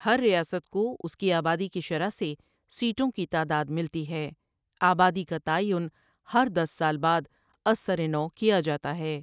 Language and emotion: Urdu, neutral